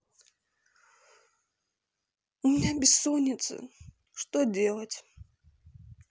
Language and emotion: Russian, sad